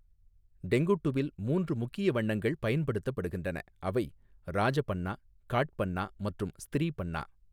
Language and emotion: Tamil, neutral